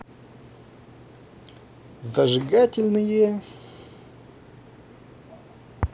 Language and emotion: Russian, positive